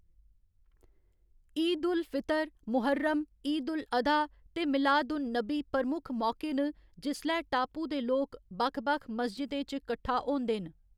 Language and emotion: Dogri, neutral